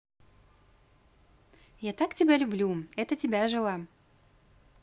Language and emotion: Russian, positive